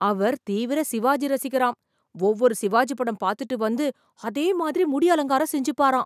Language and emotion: Tamil, surprised